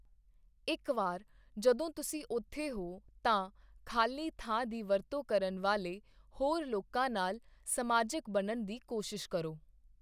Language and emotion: Punjabi, neutral